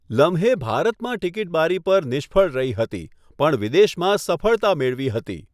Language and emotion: Gujarati, neutral